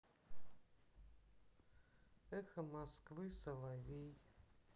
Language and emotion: Russian, sad